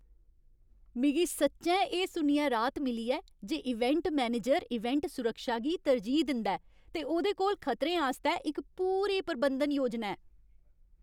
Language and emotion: Dogri, happy